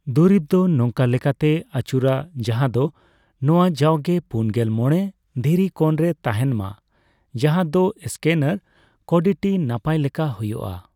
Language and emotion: Santali, neutral